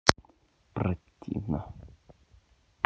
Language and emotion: Russian, angry